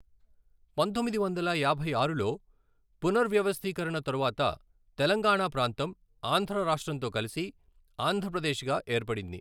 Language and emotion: Telugu, neutral